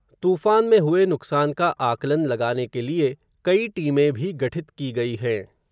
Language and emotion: Hindi, neutral